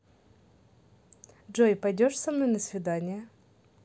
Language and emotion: Russian, positive